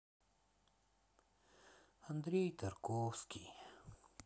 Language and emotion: Russian, sad